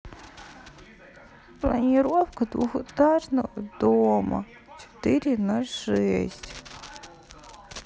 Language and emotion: Russian, sad